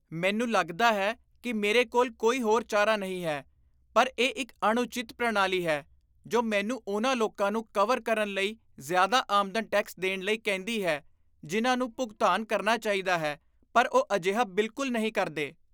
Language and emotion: Punjabi, disgusted